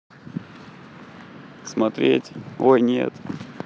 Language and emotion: Russian, neutral